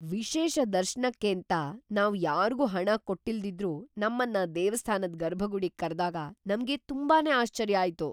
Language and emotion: Kannada, surprised